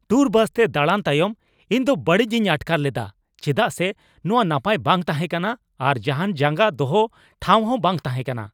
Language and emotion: Santali, angry